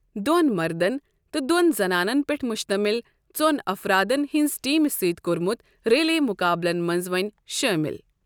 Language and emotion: Kashmiri, neutral